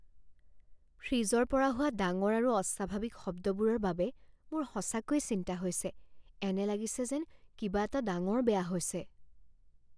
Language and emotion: Assamese, fearful